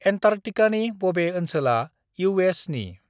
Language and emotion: Bodo, neutral